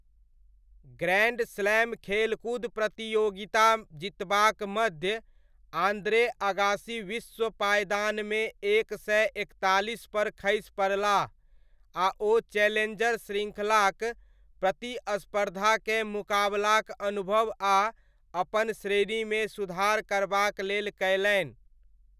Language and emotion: Maithili, neutral